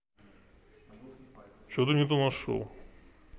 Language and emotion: Russian, neutral